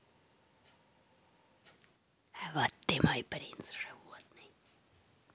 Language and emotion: Russian, neutral